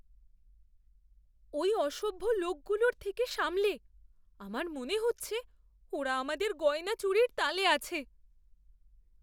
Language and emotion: Bengali, fearful